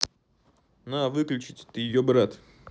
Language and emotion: Russian, angry